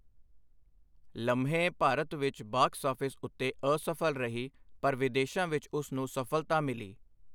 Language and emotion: Punjabi, neutral